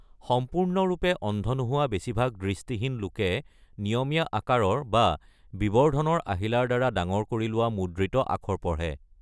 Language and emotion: Assamese, neutral